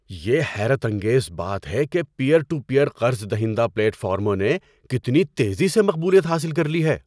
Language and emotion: Urdu, surprised